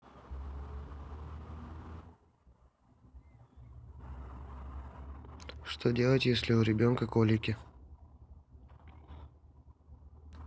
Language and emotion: Russian, neutral